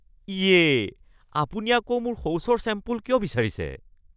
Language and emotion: Assamese, disgusted